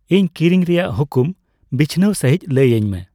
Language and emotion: Santali, neutral